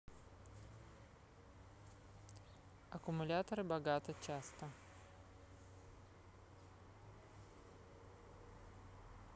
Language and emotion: Russian, neutral